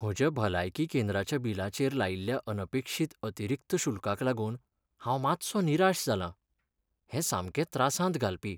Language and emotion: Goan Konkani, sad